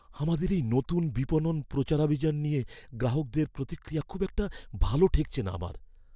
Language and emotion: Bengali, fearful